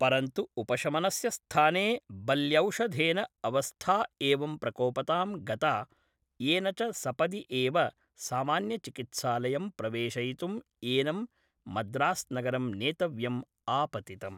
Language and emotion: Sanskrit, neutral